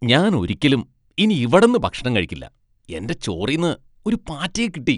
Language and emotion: Malayalam, disgusted